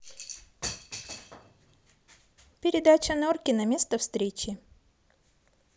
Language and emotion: Russian, neutral